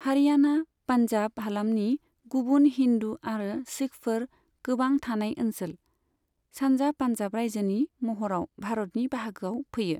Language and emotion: Bodo, neutral